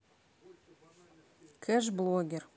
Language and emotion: Russian, neutral